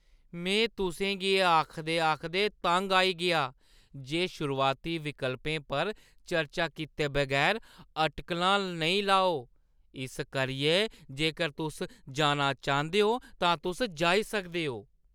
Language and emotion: Dogri, disgusted